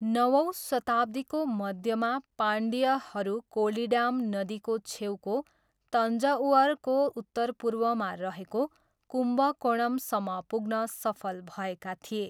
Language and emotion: Nepali, neutral